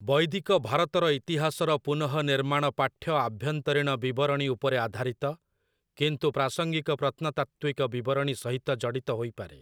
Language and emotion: Odia, neutral